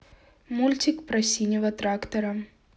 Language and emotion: Russian, neutral